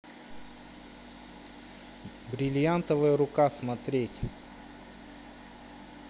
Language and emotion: Russian, neutral